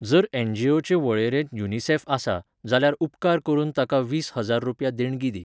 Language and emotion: Goan Konkani, neutral